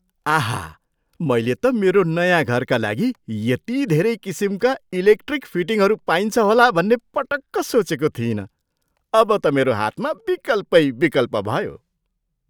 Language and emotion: Nepali, surprised